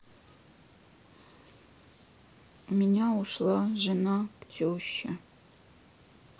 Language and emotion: Russian, sad